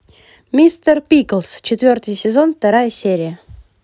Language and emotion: Russian, positive